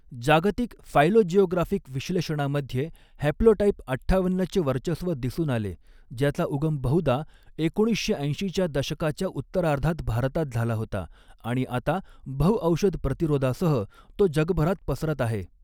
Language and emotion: Marathi, neutral